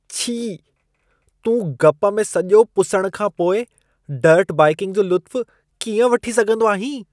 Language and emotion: Sindhi, disgusted